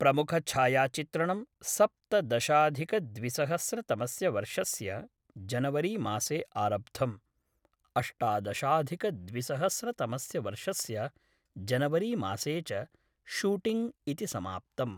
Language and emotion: Sanskrit, neutral